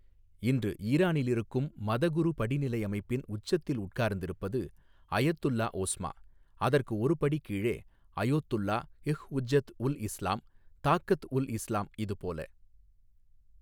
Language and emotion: Tamil, neutral